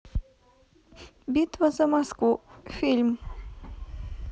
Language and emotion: Russian, neutral